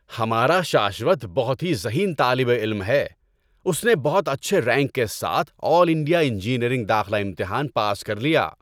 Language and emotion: Urdu, happy